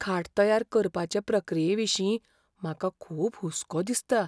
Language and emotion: Goan Konkani, fearful